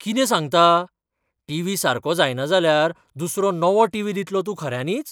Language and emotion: Goan Konkani, surprised